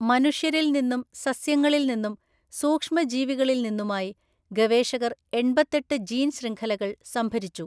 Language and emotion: Malayalam, neutral